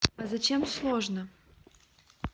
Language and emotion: Russian, neutral